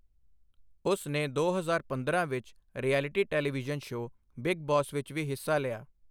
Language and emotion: Punjabi, neutral